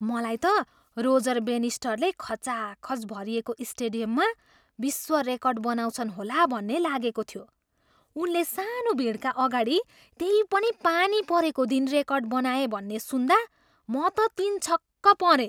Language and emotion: Nepali, surprised